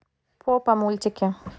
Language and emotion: Russian, neutral